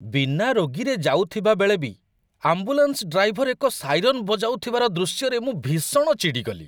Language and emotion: Odia, disgusted